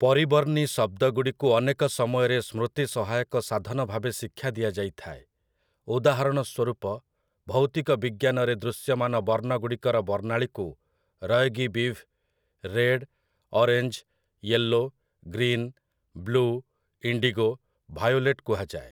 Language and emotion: Odia, neutral